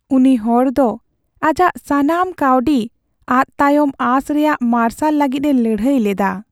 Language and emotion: Santali, sad